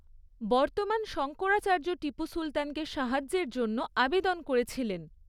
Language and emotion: Bengali, neutral